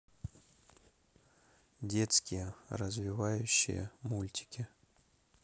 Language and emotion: Russian, neutral